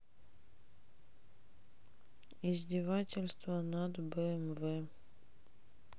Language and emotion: Russian, neutral